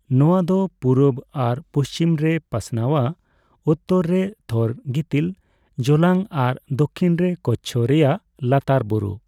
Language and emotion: Santali, neutral